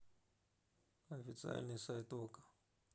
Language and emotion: Russian, neutral